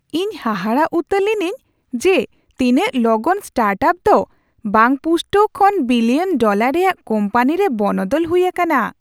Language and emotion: Santali, surprised